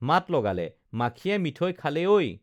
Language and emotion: Assamese, neutral